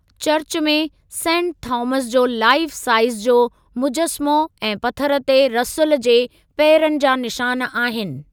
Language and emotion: Sindhi, neutral